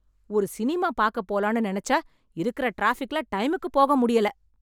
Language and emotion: Tamil, angry